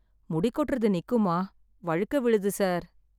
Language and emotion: Tamil, sad